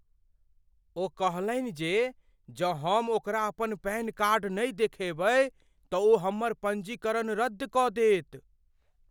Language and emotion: Maithili, fearful